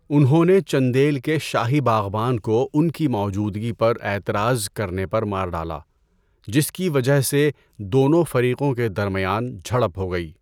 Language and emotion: Urdu, neutral